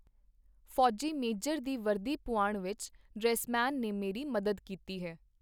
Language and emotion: Punjabi, neutral